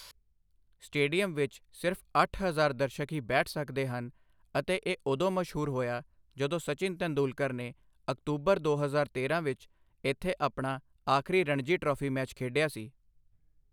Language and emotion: Punjabi, neutral